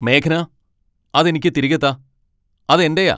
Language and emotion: Malayalam, angry